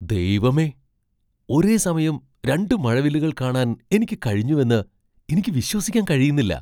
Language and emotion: Malayalam, surprised